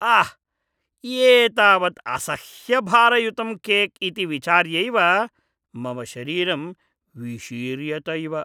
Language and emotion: Sanskrit, disgusted